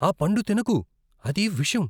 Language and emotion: Telugu, fearful